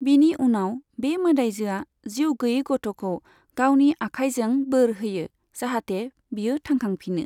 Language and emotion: Bodo, neutral